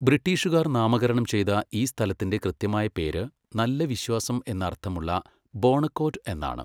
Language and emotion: Malayalam, neutral